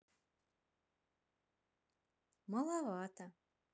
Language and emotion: Russian, neutral